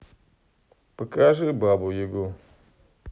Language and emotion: Russian, neutral